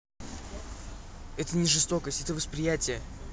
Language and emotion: Russian, neutral